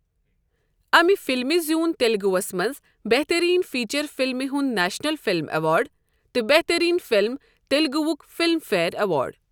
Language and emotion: Kashmiri, neutral